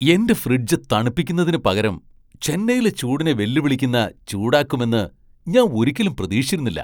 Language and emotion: Malayalam, surprised